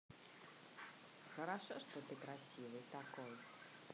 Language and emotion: Russian, positive